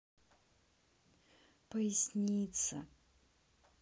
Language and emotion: Russian, sad